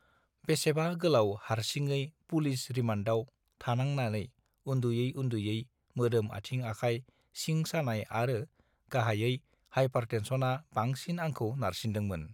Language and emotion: Bodo, neutral